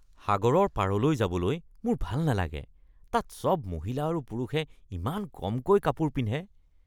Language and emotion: Assamese, disgusted